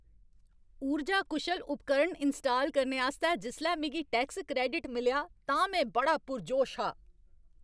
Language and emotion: Dogri, happy